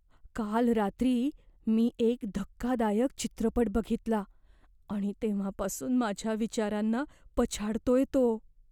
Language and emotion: Marathi, fearful